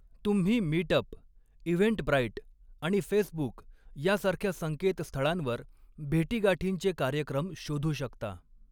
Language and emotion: Marathi, neutral